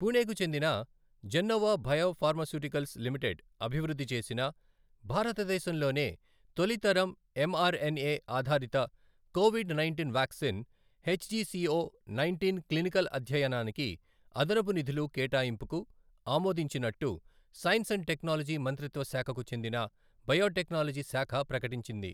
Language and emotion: Telugu, neutral